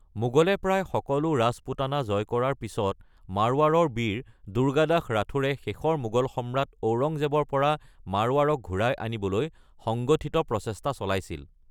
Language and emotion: Assamese, neutral